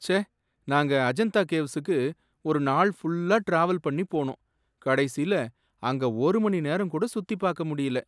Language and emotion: Tamil, sad